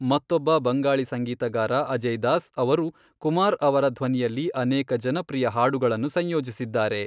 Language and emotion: Kannada, neutral